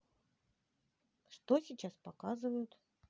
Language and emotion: Russian, neutral